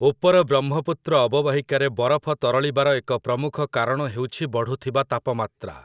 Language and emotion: Odia, neutral